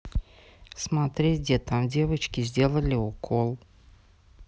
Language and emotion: Russian, neutral